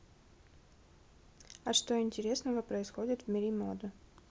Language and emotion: Russian, neutral